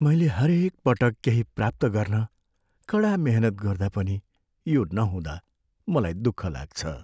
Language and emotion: Nepali, sad